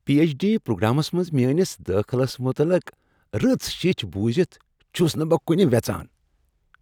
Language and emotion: Kashmiri, happy